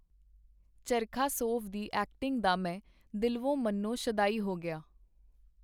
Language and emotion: Punjabi, neutral